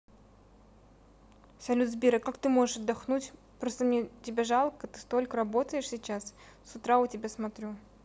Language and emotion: Russian, neutral